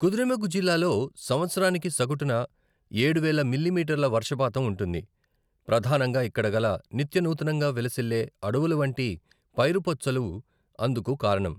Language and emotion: Telugu, neutral